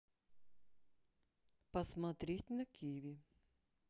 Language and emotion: Russian, neutral